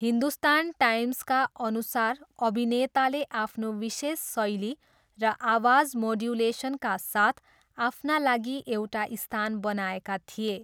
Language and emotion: Nepali, neutral